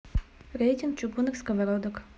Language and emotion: Russian, neutral